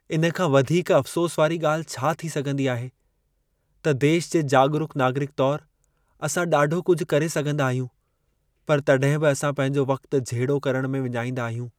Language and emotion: Sindhi, sad